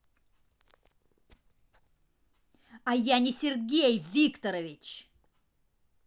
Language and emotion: Russian, angry